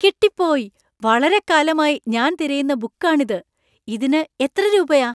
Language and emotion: Malayalam, surprised